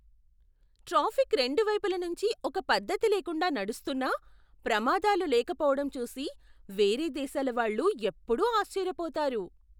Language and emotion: Telugu, surprised